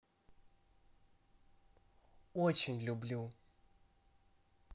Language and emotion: Russian, positive